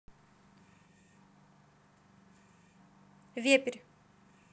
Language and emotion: Russian, neutral